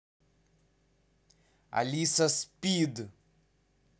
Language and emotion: Russian, angry